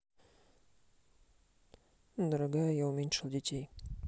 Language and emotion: Russian, neutral